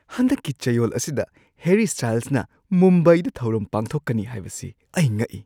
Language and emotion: Manipuri, surprised